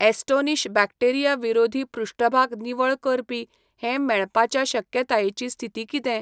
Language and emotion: Goan Konkani, neutral